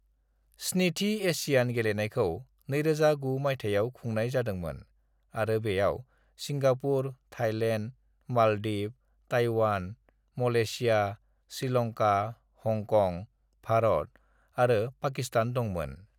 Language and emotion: Bodo, neutral